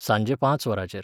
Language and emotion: Goan Konkani, neutral